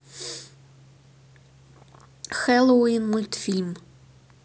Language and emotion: Russian, neutral